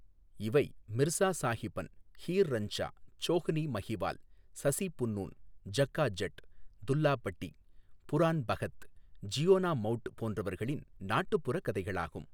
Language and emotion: Tamil, neutral